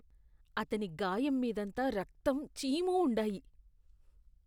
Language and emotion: Telugu, disgusted